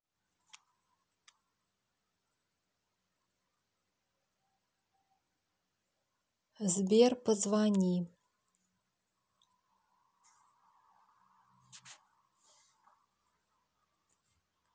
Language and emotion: Russian, neutral